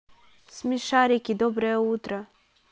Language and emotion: Russian, neutral